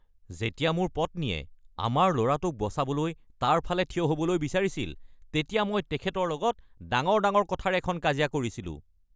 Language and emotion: Assamese, angry